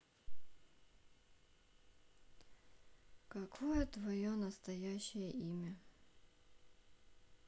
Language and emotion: Russian, sad